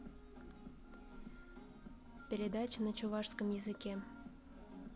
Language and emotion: Russian, neutral